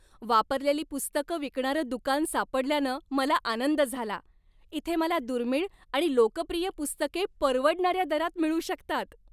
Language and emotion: Marathi, happy